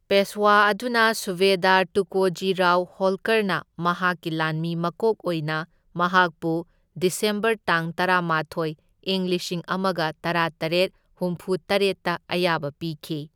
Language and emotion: Manipuri, neutral